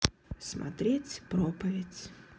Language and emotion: Russian, sad